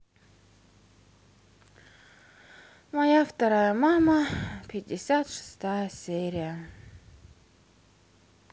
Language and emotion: Russian, sad